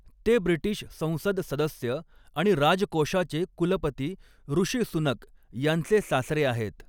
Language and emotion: Marathi, neutral